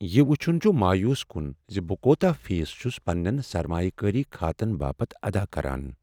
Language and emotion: Kashmiri, sad